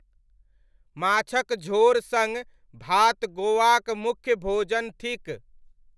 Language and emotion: Maithili, neutral